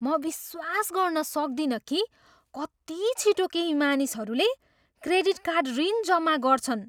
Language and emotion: Nepali, surprised